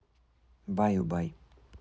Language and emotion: Russian, neutral